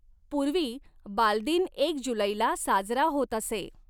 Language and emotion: Marathi, neutral